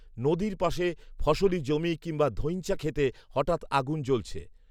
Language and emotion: Bengali, neutral